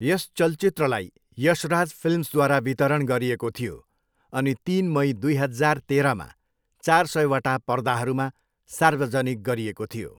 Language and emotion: Nepali, neutral